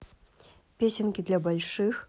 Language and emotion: Russian, neutral